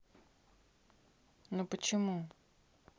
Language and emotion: Russian, neutral